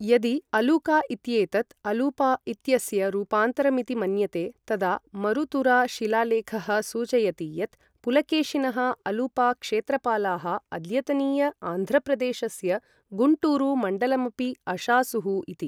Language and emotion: Sanskrit, neutral